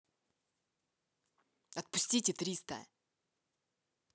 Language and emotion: Russian, angry